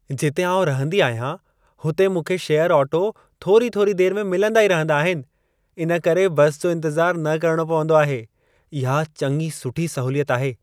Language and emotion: Sindhi, happy